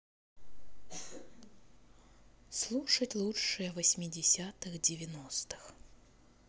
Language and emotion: Russian, neutral